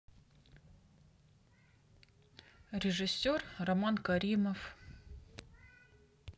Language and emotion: Russian, neutral